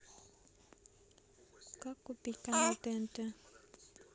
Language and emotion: Russian, neutral